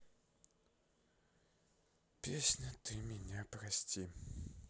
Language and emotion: Russian, sad